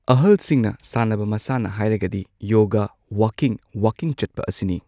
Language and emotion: Manipuri, neutral